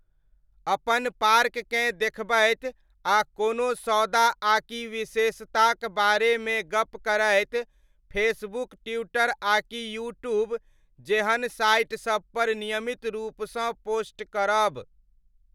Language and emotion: Maithili, neutral